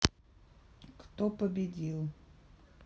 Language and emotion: Russian, neutral